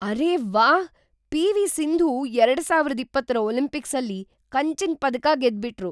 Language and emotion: Kannada, surprised